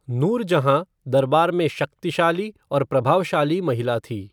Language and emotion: Hindi, neutral